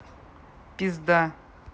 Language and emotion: Russian, neutral